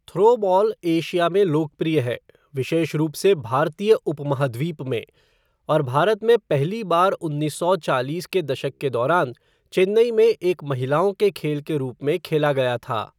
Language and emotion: Hindi, neutral